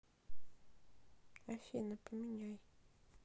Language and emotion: Russian, neutral